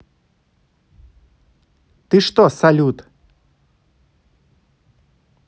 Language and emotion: Russian, angry